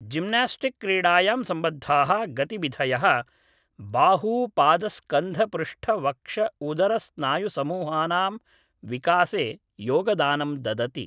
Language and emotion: Sanskrit, neutral